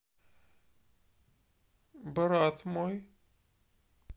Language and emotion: Russian, neutral